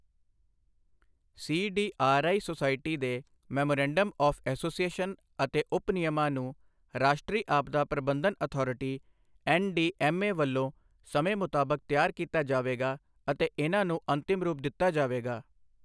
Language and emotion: Punjabi, neutral